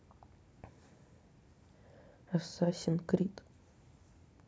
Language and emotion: Russian, neutral